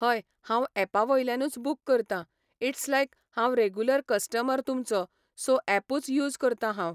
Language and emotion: Goan Konkani, neutral